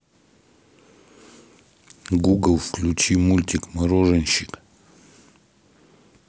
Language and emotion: Russian, neutral